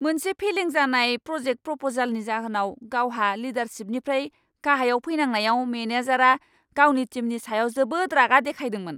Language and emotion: Bodo, angry